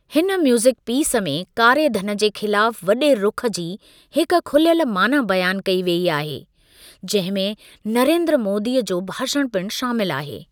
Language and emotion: Sindhi, neutral